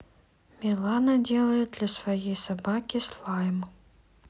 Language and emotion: Russian, neutral